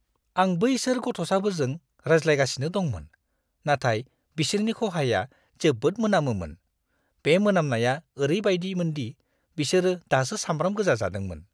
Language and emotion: Bodo, disgusted